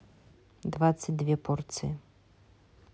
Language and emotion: Russian, neutral